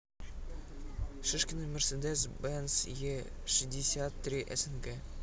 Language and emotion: Russian, neutral